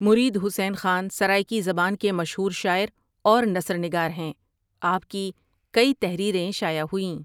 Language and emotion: Urdu, neutral